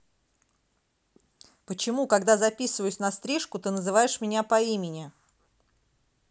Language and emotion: Russian, angry